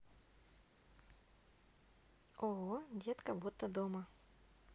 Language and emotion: Russian, positive